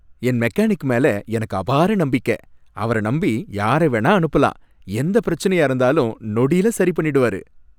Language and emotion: Tamil, happy